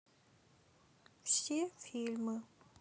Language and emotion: Russian, neutral